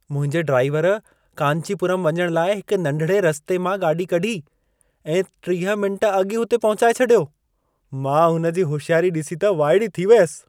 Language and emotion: Sindhi, surprised